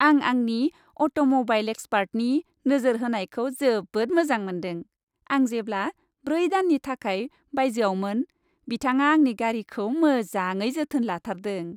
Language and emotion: Bodo, happy